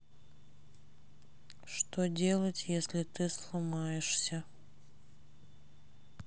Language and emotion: Russian, sad